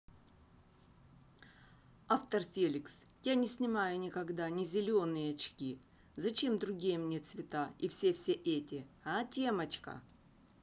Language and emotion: Russian, neutral